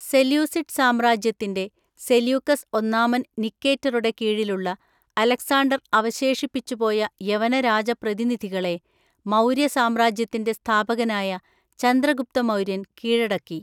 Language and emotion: Malayalam, neutral